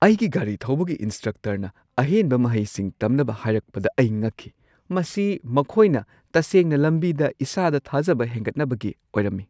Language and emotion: Manipuri, surprised